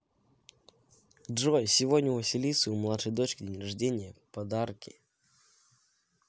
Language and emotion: Russian, positive